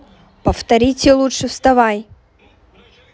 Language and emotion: Russian, angry